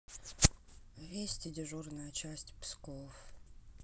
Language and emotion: Russian, neutral